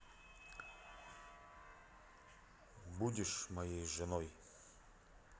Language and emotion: Russian, neutral